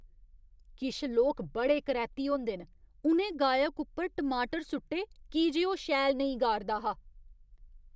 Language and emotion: Dogri, disgusted